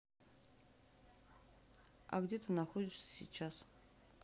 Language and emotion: Russian, neutral